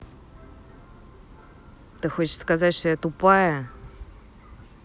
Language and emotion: Russian, angry